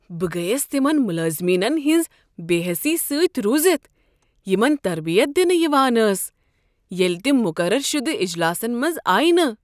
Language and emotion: Kashmiri, surprised